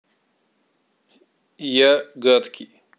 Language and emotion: Russian, neutral